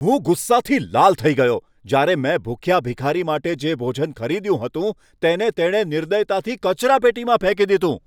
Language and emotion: Gujarati, angry